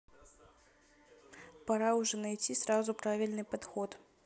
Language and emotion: Russian, neutral